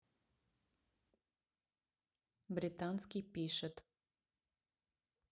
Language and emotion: Russian, neutral